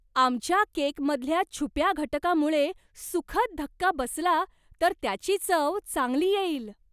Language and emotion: Marathi, surprised